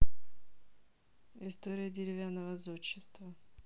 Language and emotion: Russian, neutral